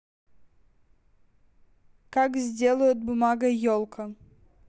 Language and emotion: Russian, neutral